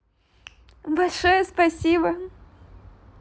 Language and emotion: Russian, positive